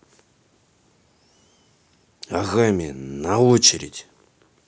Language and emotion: Russian, angry